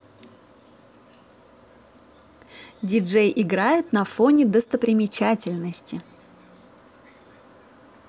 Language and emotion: Russian, positive